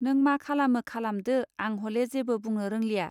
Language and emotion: Bodo, neutral